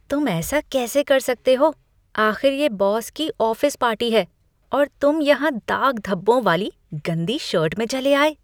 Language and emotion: Hindi, disgusted